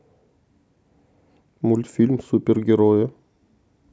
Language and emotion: Russian, neutral